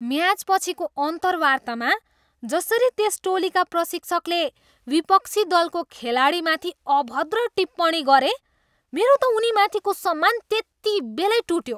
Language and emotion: Nepali, disgusted